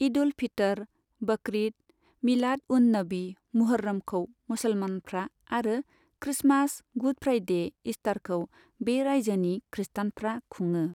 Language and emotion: Bodo, neutral